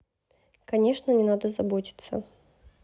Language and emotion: Russian, neutral